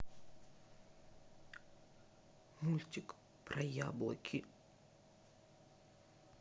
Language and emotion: Russian, sad